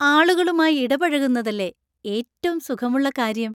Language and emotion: Malayalam, happy